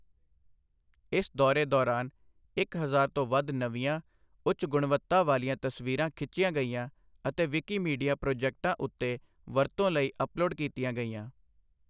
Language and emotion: Punjabi, neutral